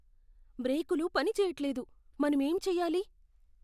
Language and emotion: Telugu, fearful